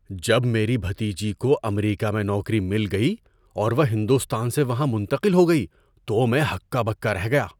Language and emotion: Urdu, surprised